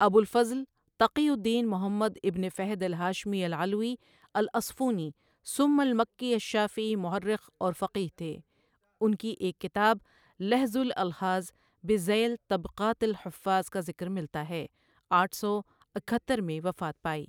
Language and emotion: Urdu, neutral